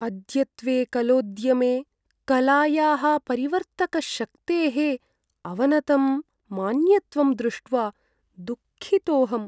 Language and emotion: Sanskrit, sad